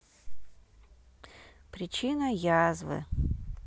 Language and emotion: Russian, neutral